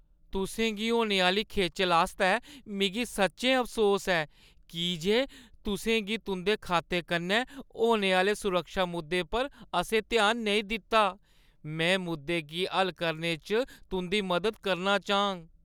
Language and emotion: Dogri, sad